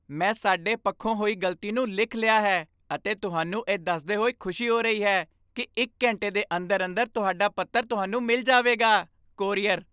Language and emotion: Punjabi, happy